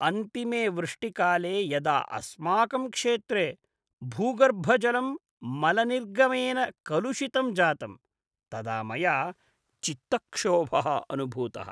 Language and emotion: Sanskrit, disgusted